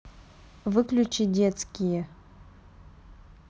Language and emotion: Russian, neutral